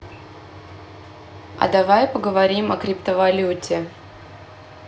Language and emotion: Russian, neutral